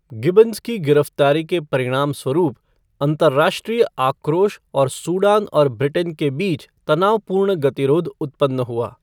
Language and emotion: Hindi, neutral